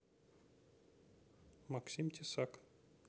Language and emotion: Russian, neutral